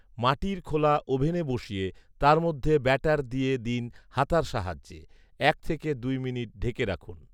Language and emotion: Bengali, neutral